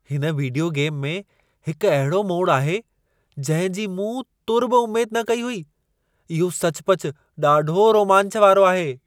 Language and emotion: Sindhi, surprised